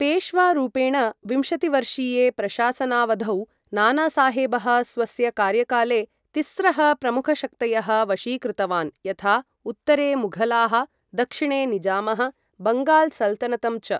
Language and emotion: Sanskrit, neutral